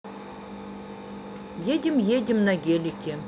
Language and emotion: Russian, neutral